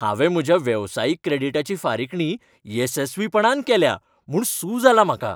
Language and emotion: Goan Konkani, happy